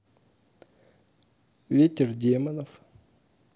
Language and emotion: Russian, neutral